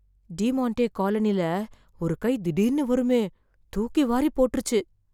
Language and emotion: Tamil, fearful